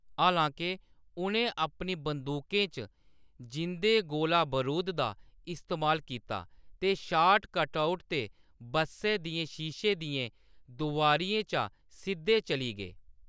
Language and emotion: Dogri, neutral